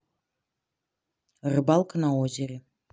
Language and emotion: Russian, neutral